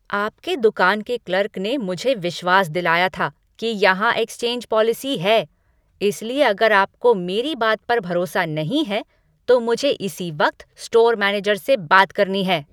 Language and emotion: Hindi, angry